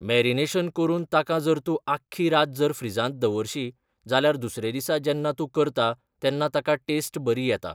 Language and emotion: Goan Konkani, neutral